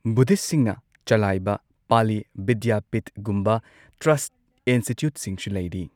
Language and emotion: Manipuri, neutral